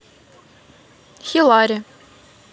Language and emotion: Russian, neutral